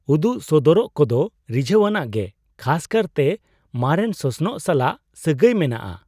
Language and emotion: Santali, surprised